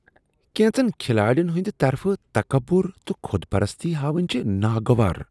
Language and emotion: Kashmiri, disgusted